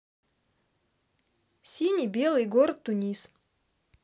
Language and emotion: Russian, neutral